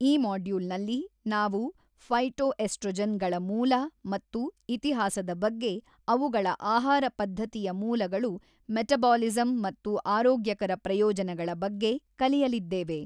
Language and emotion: Kannada, neutral